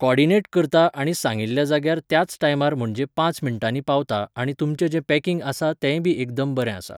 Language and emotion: Goan Konkani, neutral